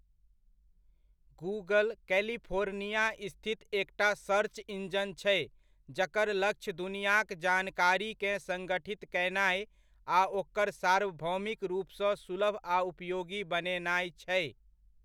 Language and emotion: Maithili, neutral